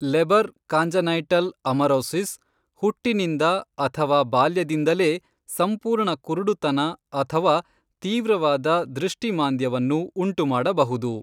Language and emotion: Kannada, neutral